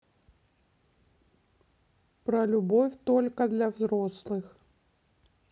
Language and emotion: Russian, neutral